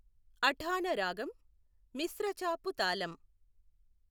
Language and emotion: Telugu, neutral